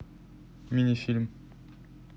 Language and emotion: Russian, neutral